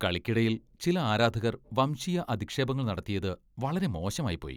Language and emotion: Malayalam, disgusted